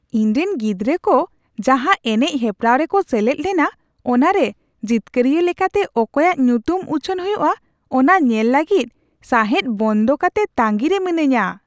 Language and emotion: Santali, surprised